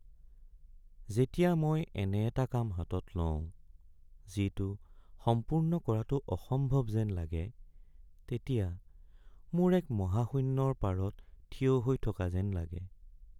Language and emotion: Assamese, sad